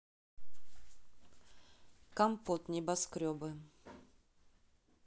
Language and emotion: Russian, neutral